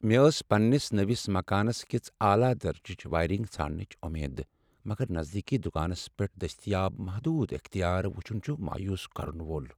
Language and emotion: Kashmiri, sad